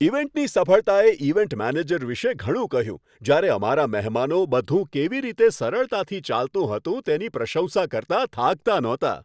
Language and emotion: Gujarati, happy